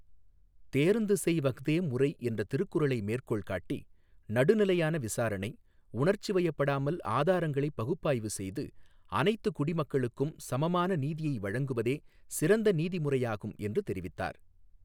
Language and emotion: Tamil, neutral